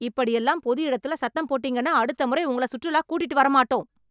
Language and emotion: Tamil, angry